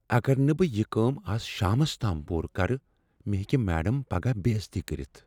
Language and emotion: Kashmiri, fearful